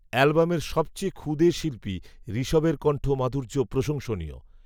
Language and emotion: Bengali, neutral